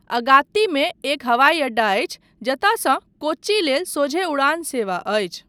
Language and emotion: Maithili, neutral